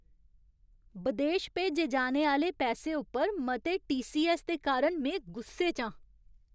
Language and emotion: Dogri, angry